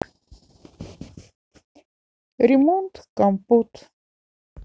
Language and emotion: Russian, neutral